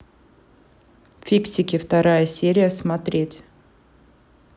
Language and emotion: Russian, neutral